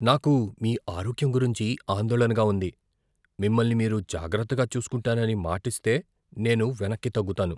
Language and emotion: Telugu, fearful